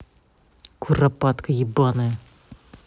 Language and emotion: Russian, angry